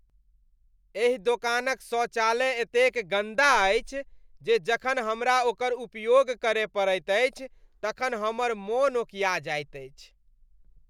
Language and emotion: Maithili, disgusted